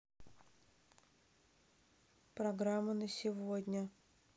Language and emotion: Russian, neutral